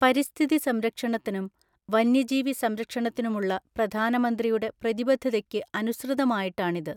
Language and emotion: Malayalam, neutral